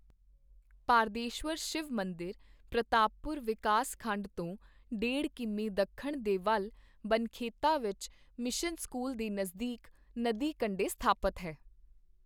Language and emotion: Punjabi, neutral